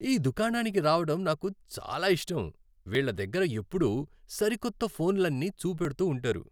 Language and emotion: Telugu, happy